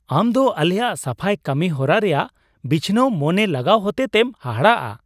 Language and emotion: Santali, surprised